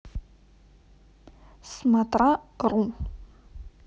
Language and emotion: Russian, neutral